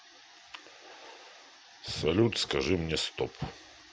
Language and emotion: Russian, neutral